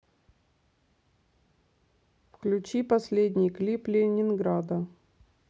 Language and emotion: Russian, neutral